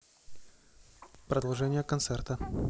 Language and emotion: Russian, neutral